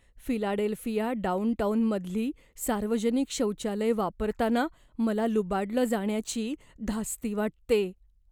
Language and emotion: Marathi, fearful